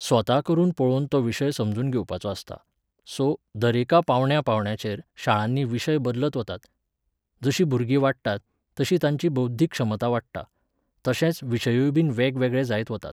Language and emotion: Goan Konkani, neutral